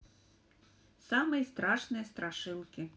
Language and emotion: Russian, neutral